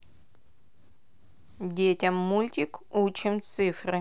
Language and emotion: Russian, neutral